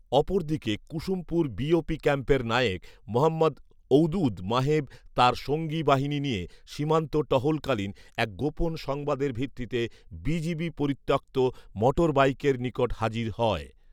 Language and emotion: Bengali, neutral